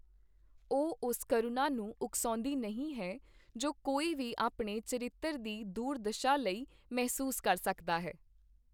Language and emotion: Punjabi, neutral